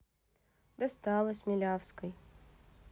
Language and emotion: Russian, neutral